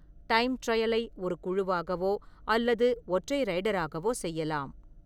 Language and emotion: Tamil, neutral